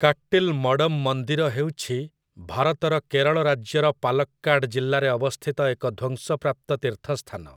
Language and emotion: Odia, neutral